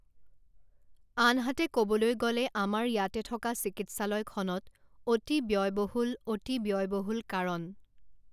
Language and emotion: Assamese, neutral